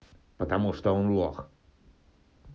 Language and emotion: Russian, angry